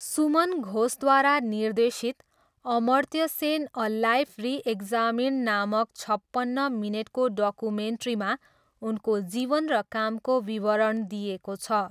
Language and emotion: Nepali, neutral